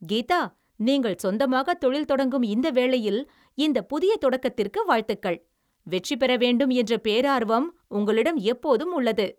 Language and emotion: Tamil, happy